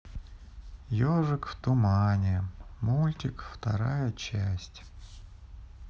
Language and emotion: Russian, sad